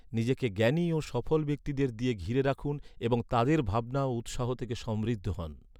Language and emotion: Bengali, neutral